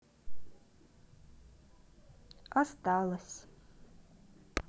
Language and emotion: Russian, sad